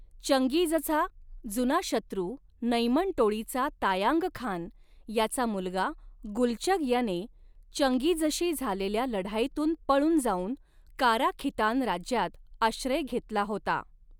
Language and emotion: Marathi, neutral